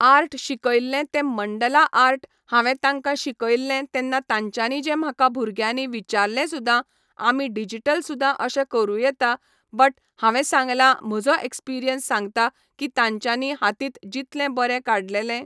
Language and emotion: Goan Konkani, neutral